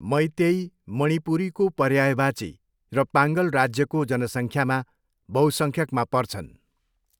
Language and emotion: Nepali, neutral